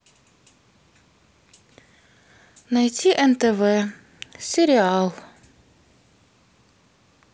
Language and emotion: Russian, neutral